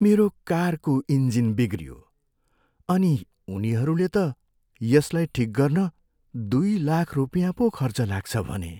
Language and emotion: Nepali, sad